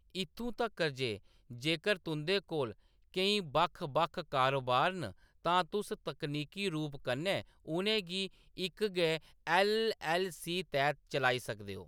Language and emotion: Dogri, neutral